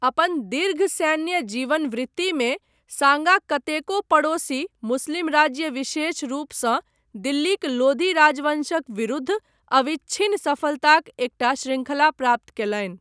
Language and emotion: Maithili, neutral